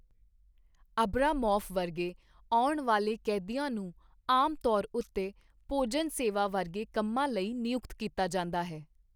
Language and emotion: Punjabi, neutral